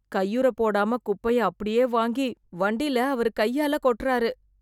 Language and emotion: Tamil, disgusted